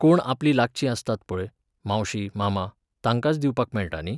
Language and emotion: Goan Konkani, neutral